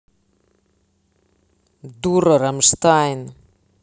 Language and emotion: Russian, angry